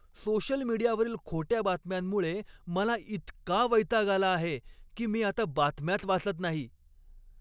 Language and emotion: Marathi, angry